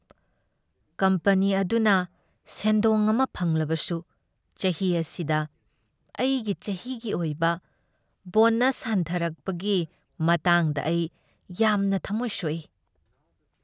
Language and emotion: Manipuri, sad